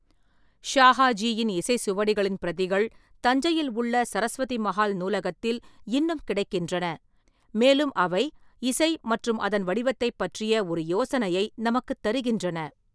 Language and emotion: Tamil, neutral